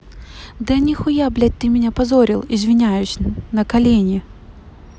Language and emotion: Russian, angry